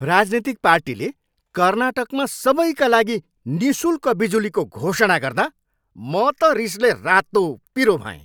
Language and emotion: Nepali, angry